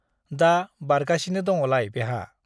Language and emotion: Bodo, neutral